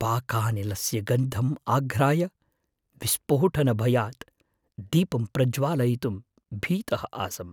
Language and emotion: Sanskrit, fearful